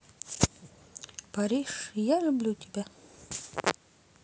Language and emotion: Russian, neutral